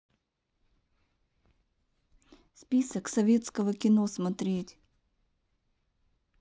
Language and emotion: Russian, neutral